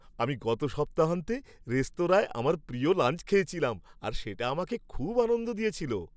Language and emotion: Bengali, happy